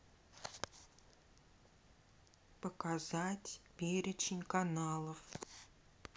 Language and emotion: Russian, neutral